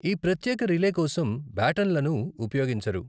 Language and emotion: Telugu, neutral